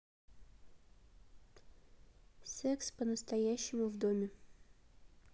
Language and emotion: Russian, neutral